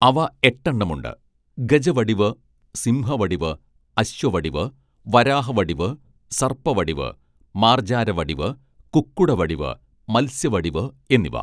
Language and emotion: Malayalam, neutral